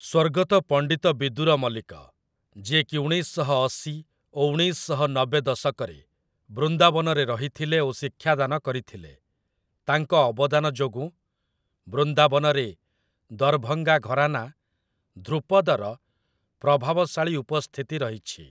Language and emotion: Odia, neutral